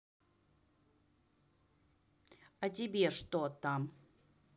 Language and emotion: Russian, neutral